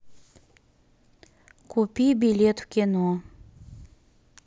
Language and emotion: Russian, neutral